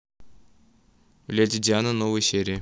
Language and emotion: Russian, neutral